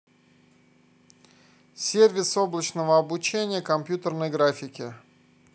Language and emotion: Russian, neutral